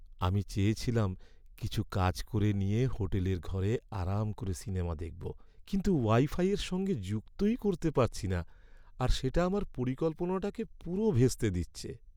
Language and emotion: Bengali, sad